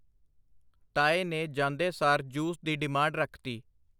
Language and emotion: Punjabi, neutral